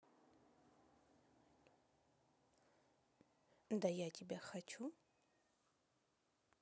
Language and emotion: Russian, neutral